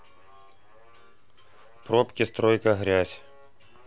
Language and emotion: Russian, neutral